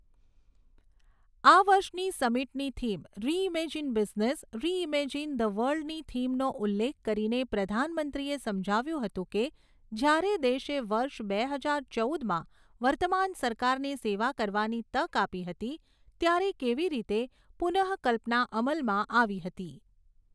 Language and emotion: Gujarati, neutral